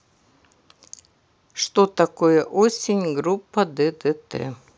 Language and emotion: Russian, neutral